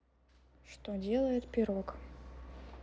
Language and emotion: Russian, neutral